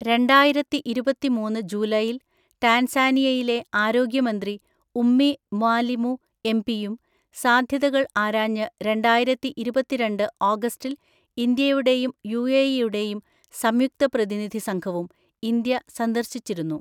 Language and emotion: Malayalam, neutral